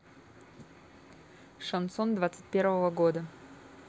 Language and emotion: Russian, neutral